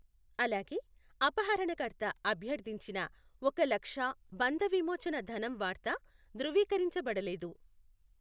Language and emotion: Telugu, neutral